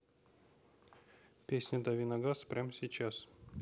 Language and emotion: Russian, neutral